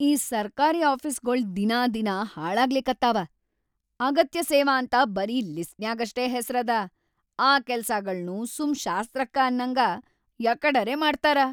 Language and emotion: Kannada, angry